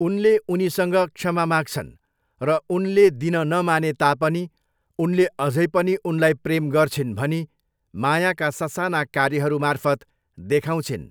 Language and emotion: Nepali, neutral